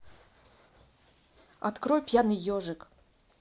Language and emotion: Russian, neutral